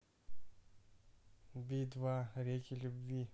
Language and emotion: Russian, neutral